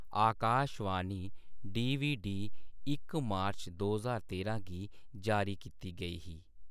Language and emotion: Dogri, neutral